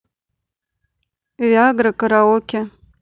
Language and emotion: Russian, neutral